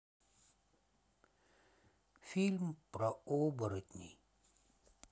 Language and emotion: Russian, sad